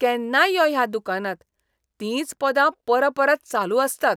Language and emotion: Goan Konkani, disgusted